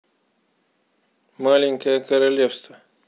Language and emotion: Russian, neutral